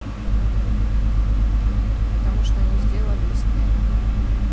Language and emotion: Russian, neutral